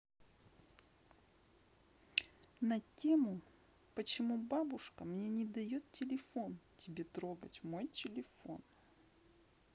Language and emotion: Russian, neutral